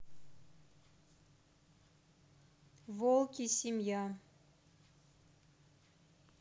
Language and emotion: Russian, neutral